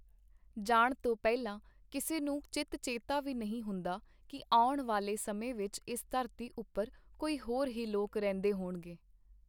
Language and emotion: Punjabi, neutral